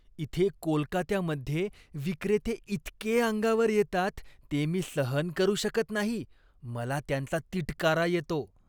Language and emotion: Marathi, disgusted